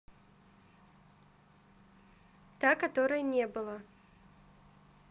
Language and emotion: Russian, neutral